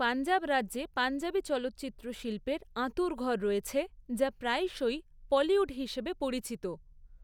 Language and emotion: Bengali, neutral